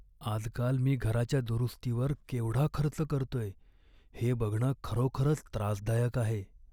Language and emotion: Marathi, sad